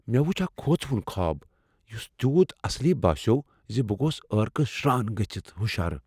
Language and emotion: Kashmiri, fearful